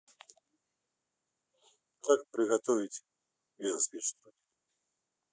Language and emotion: Russian, neutral